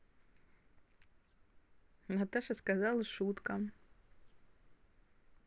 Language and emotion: Russian, positive